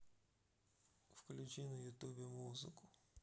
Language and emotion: Russian, neutral